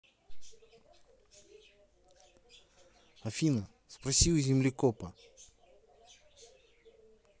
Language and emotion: Russian, neutral